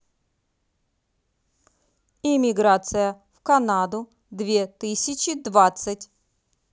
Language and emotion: Russian, neutral